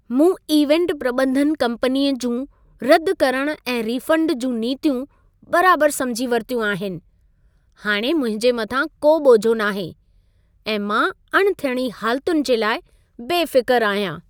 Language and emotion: Sindhi, happy